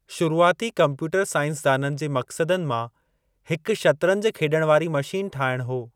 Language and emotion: Sindhi, neutral